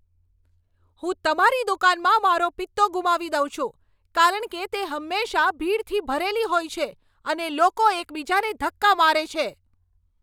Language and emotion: Gujarati, angry